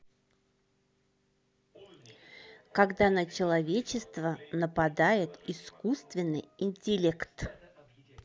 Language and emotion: Russian, neutral